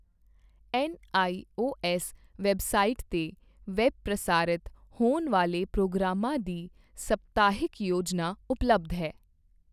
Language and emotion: Punjabi, neutral